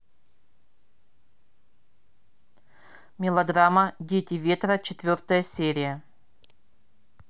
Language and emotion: Russian, neutral